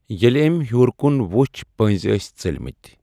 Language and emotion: Kashmiri, neutral